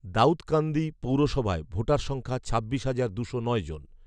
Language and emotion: Bengali, neutral